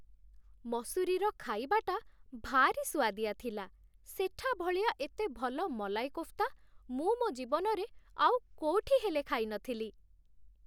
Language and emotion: Odia, happy